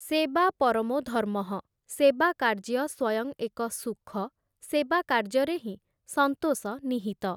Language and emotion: Odia, neutral